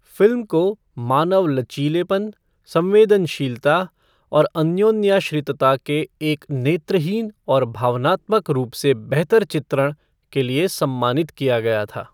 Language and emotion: Hindi, neutral